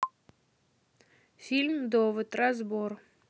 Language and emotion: Russian, neutral